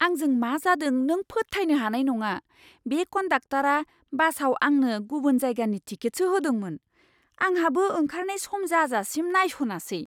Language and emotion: Bodo, surprised